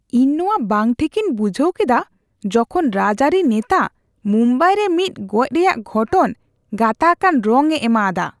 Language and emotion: Santali, disgusted